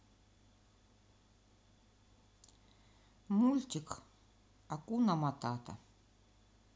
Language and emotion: Russian, neutral